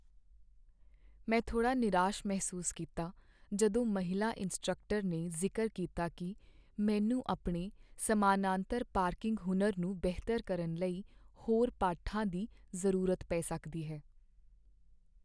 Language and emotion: Punjabi, sad